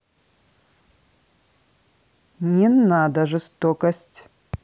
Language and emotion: Russian, angry